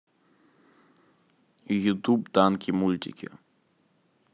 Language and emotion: Russian, neutral